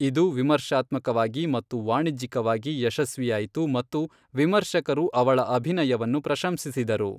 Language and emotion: Kannada, neutral